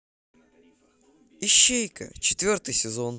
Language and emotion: Russian, positive